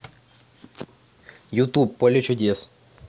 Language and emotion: Russian, neutral